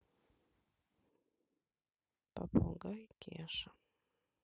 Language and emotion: Russian, neutral